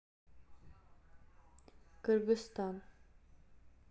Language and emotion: Russian, neutral